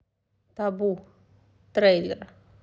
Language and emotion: Russian, neutral